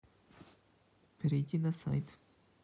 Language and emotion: Russian, neutral